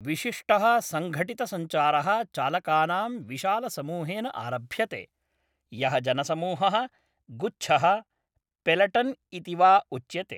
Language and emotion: Sanskrit, neutral